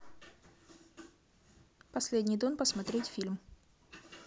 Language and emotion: Russian, neutral